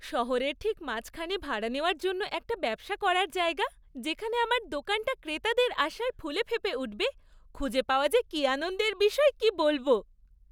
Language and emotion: Bengali, happy